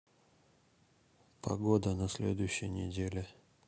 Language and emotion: Russian, neutral